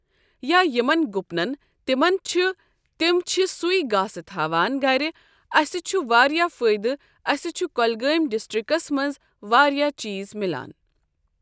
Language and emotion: Kashmiri, neutral